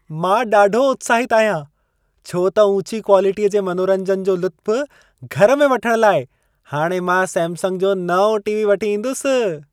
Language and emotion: Sindhi, happy